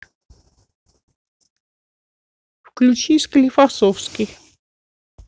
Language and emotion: Russian, neutral